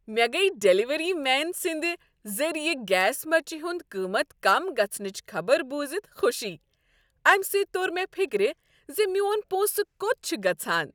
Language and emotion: Kashmiri, happy